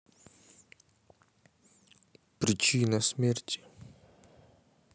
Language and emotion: Russian, neutral